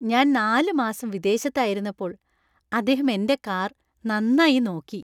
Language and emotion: Malayalam, happy